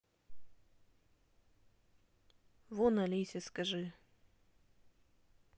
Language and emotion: Russian, neutral